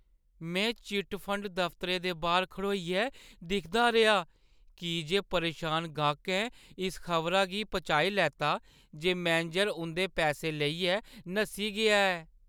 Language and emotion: Dogri, sad